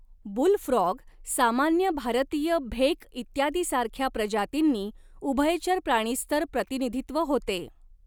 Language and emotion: Marathi, neutral